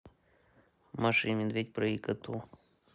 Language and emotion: Russian, neutral